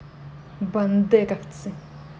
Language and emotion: Russian, angry